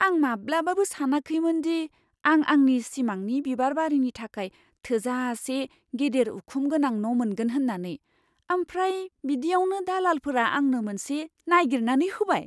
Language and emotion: Bodo, surprised